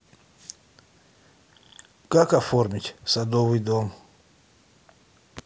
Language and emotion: Russian, neutral